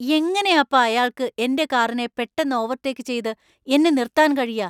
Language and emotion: Malayalam, angry